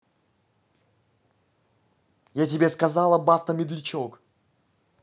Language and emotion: Russian, angry